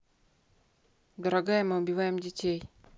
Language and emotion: Russian, neutral